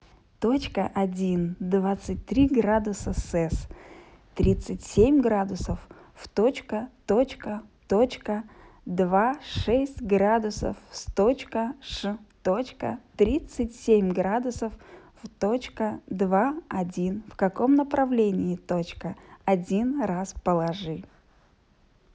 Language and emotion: Russian, positive